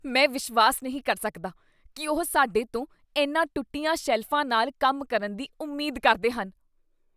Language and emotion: Punjabi, disgusted